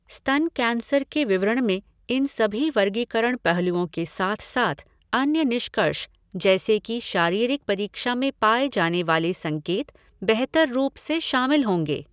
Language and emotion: Hindi, neutral